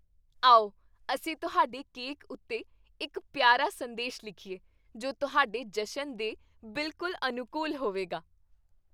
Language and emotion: Punjabi, happy